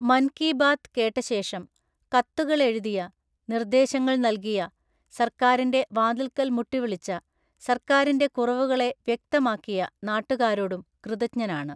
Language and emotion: Malayalam, neutral